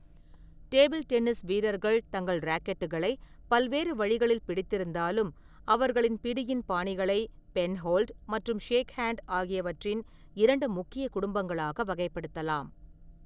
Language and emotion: Tamil, neutral